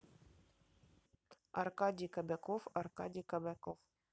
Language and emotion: Russian, neutral